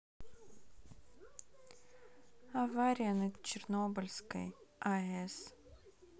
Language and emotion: Russian, sad